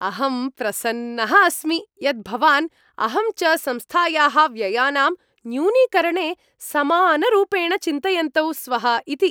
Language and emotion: Sanskrit, happy